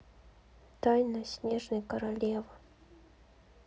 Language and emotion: Russian, sad